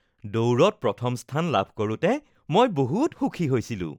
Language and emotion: Assamese, happy